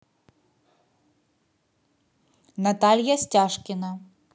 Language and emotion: Russian, neutral